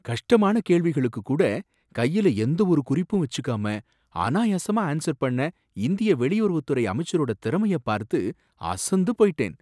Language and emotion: Tamil, surprised